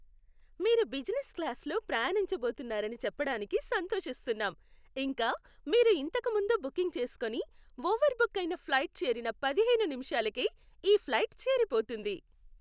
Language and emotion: Telugu, happy